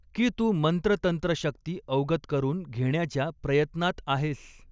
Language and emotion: Marathi, neutral